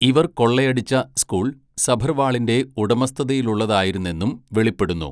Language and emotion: Malayalam, neutral